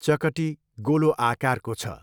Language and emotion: Nepali, neutral